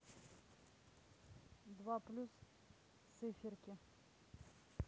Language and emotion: Russian, neutral